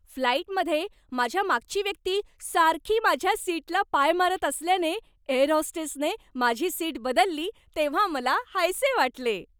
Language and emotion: Marathi, happy